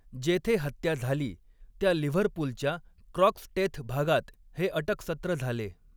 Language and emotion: Marathi, neutral